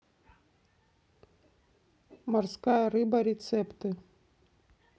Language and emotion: Russian, neutral